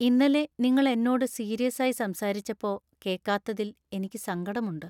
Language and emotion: Malayalam, sad